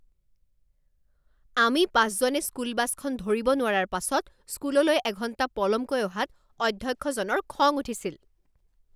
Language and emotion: Assamese, angry